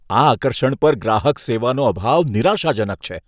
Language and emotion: Gujarati, disgusted